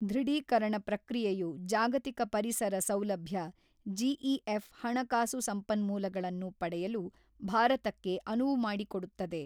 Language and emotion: Kannada, neutral